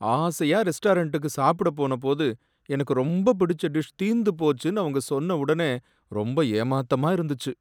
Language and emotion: Tamil, sad